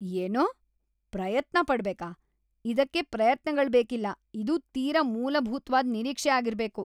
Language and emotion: Kannada, disgusted